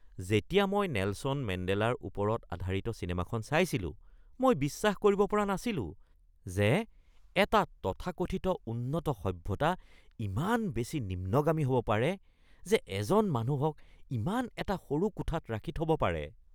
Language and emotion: Assamese, disgusted